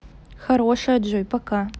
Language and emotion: Russian, neutral